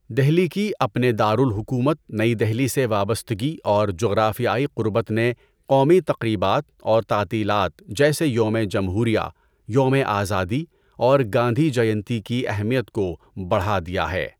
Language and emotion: Urdu, neutral